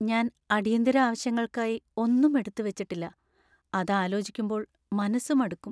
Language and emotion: Malayalam, sad